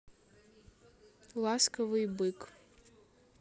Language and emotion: Russian, neutral